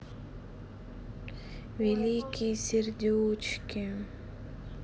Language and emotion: Russian, sad